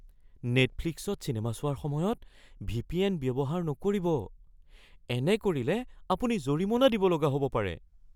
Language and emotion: Assamese, fearful